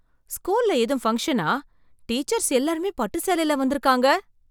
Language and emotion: Tamil, surprised